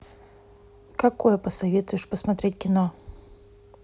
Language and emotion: Russian, neutral